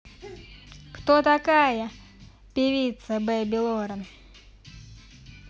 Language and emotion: Russian, angry